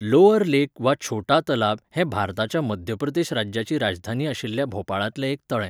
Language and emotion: Goan Konkani, neutral